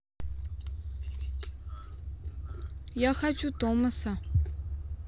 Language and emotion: Russian, neutral